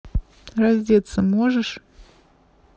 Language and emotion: Russian, neutral